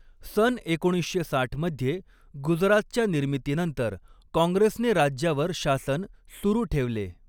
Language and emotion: Marathi, neutral